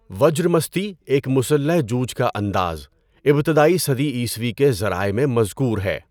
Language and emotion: Urdu, neutral